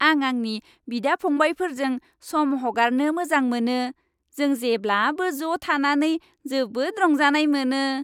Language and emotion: Bodo, happy